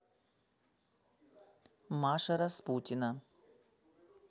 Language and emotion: Russian, neutral